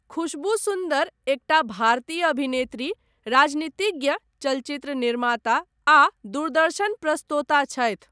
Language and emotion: Maithili, neutral